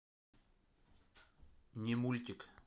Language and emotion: Russian, neutral